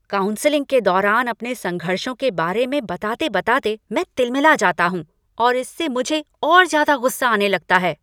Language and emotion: Hindi, angry